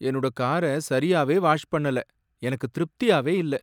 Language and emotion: Tamil, sad